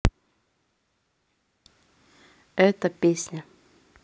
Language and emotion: Russian, neutral